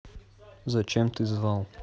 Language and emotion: Russian, neutral